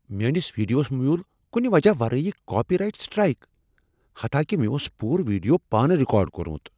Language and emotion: Kashmiri, angry